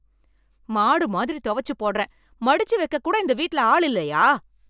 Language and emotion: Tamil, angry